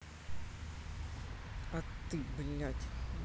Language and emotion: Russian, angry